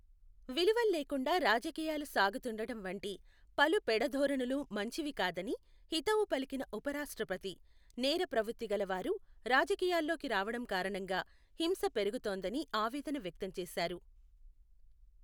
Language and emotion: Telugu, neutral